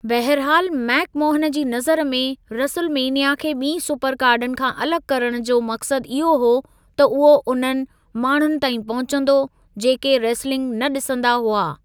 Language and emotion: Sindhi, neutral